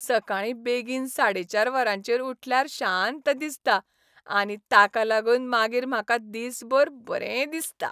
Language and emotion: Goan Konkani, happy